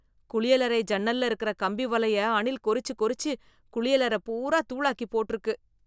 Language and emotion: Tamil, disgusted